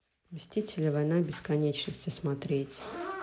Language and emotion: Russian, neutral